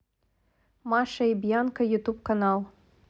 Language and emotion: Russian, neutral